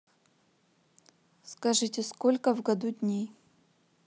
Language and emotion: Russian, neutral